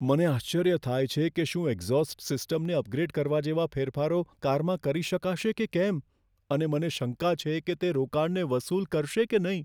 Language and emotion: Gujarati, fearful